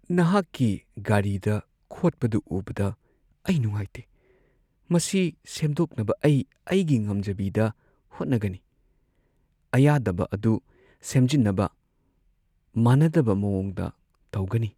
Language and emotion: Manipuri, sad